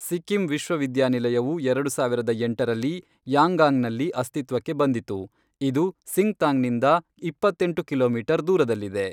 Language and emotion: Kannada, neutral